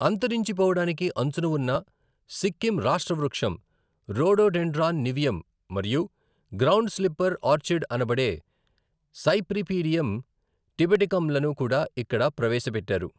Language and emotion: Telugu, neutral